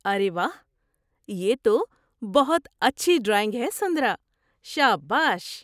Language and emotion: Urdu, surprised